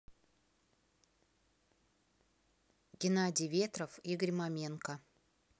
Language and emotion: Russian, neutral